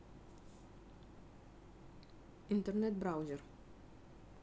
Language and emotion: Russian, neutral